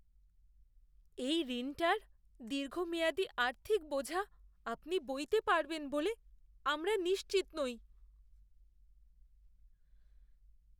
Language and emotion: Bengali, fearful